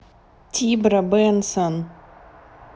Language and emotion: Russian, neutral